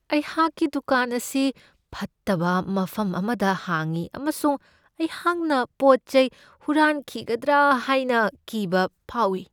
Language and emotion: Manipuri, fearful